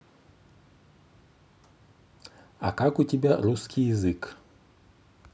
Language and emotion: Russian, neutral